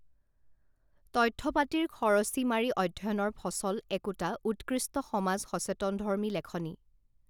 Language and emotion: Assamese, neutral